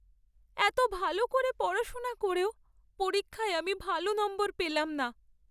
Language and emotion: Bengali, sad